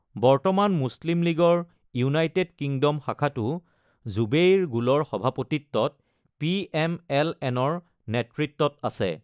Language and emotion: Assamese, neutral